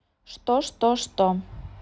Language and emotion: Russian, neutral